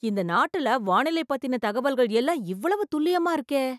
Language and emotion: Tamil, surprised